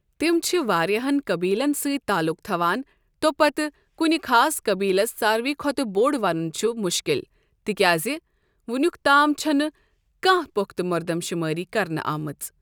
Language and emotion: Kashmiri, neutral